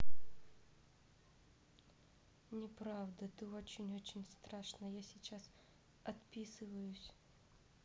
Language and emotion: Russian, neutral